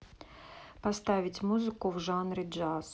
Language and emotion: Russian, neutral